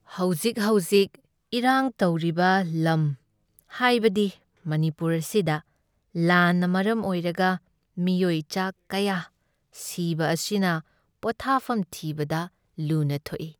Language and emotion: Manipuri, sad